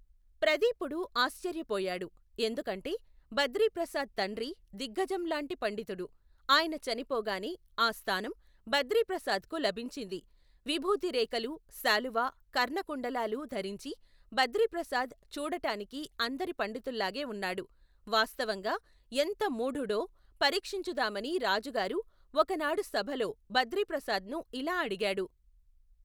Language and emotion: Telugu, neutral